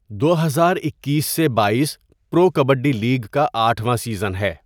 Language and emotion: Urdu, neutral